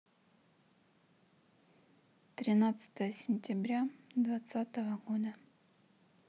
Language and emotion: Russian, neutral